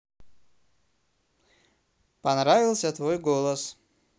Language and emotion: Russian, neutral